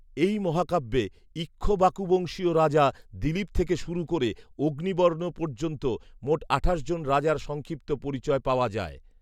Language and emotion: Bengali, neutral